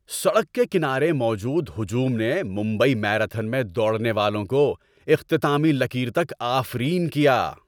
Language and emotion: Urdu, happy